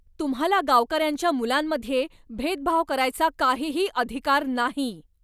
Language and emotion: Marathi, angry